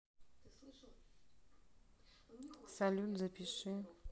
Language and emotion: Russian, neutral